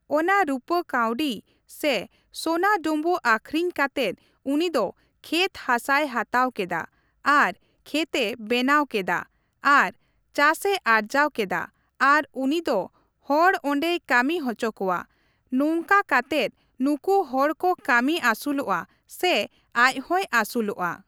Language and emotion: Santali, neutral